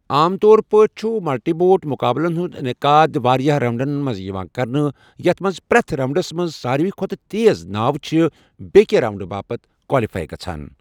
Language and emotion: Kashmiri, neutral